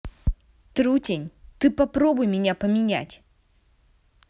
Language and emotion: Russian, angry